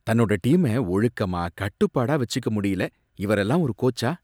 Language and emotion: Tamil, disgusted